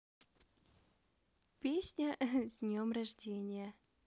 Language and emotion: Russian, positive